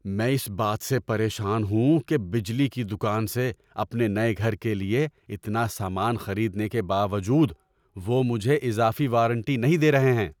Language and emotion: Urdu, angry